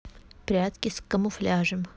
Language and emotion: Russian, neutral